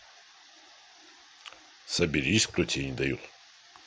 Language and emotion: Russian, neutral